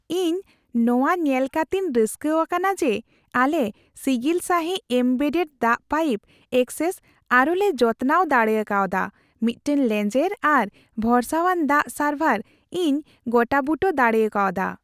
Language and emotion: Santali, happy